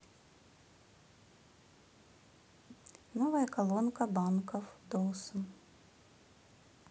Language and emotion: Russian, neutral